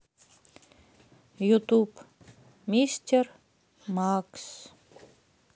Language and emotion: Russian, sad